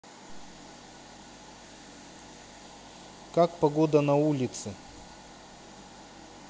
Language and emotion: Russian, neutral